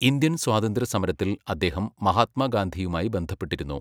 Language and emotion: Malayalam, neutral